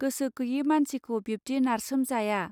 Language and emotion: Bodo, neutral